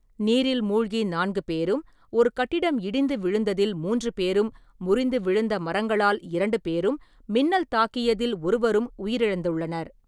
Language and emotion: Tamil, neutral